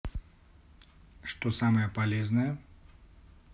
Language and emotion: Russian, neutral